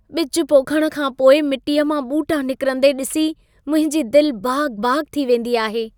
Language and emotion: Sindhi, happy